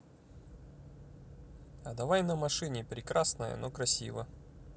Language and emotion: Russian, neutral